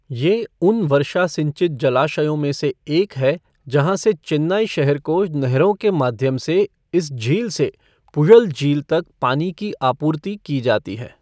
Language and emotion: Hindi, neutral